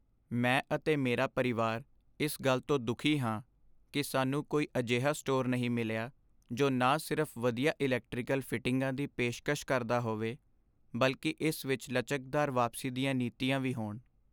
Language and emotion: Punjabi, sad